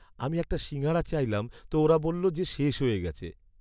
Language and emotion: Bengali, sad